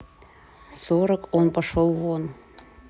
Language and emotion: Russian, neutral